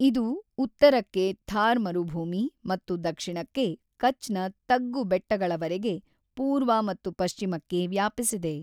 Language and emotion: Kannada, neutral